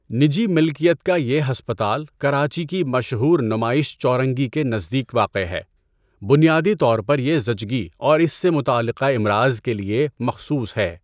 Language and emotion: Urdu, neutral